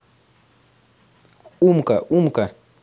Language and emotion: Russian, positive